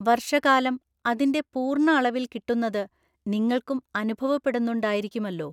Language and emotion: Malayalam, neutral